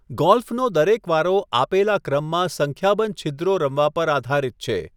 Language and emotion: Gujarati, neutral